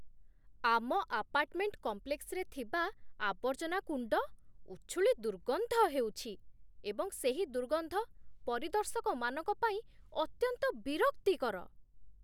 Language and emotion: Odia, disgusted